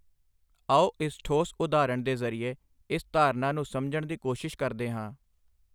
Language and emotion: Punjabi, neutral